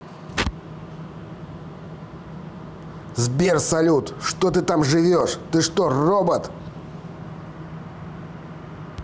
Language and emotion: Russian, angry